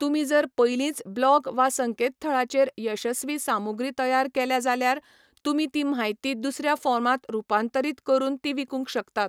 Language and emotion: Goan Konkani, neutral